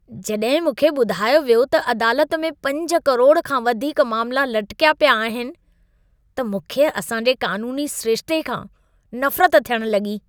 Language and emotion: Sindhi, disgusted